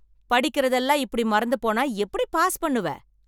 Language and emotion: Tamil, angry